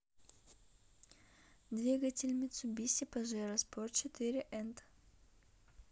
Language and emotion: Russian, neutral